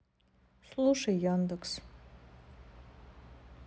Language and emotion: Russian, sad